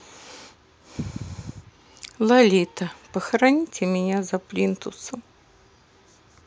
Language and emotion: Russian, sad